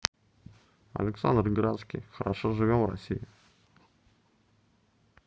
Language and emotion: Russian, neutral